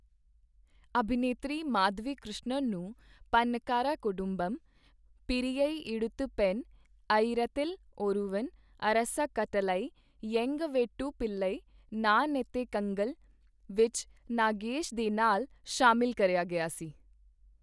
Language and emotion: Punjabi, neutral